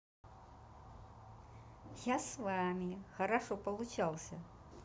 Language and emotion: Russian, positive